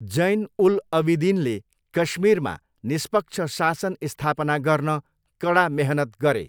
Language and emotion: Nepali, neutral